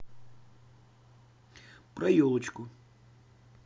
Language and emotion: Russian, neutral